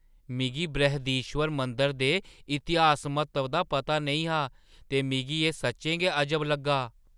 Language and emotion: Dogri, surprised